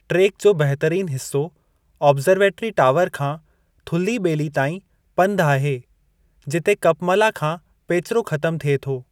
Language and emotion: Sindhi, neutral